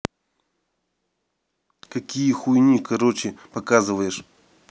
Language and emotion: Russian, angry